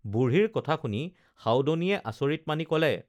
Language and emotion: Assamese, neutral